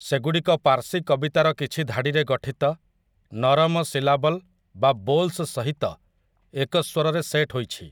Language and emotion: Odia, neutral